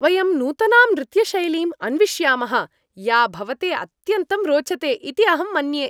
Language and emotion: Sanskrit, happy